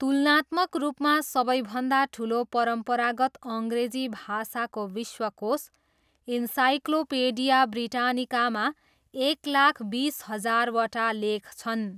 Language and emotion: Nepali, neutral